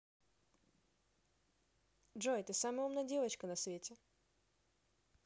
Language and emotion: Russian, positive